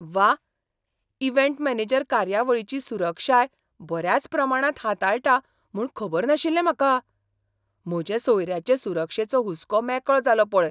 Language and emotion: Goan Konkani, surprised